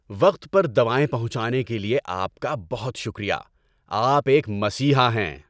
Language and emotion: Urdu, happy